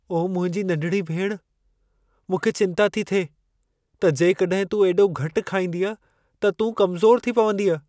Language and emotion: Sindhi, fearful